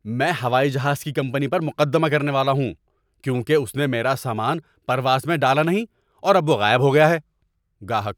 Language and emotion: Urdu, angry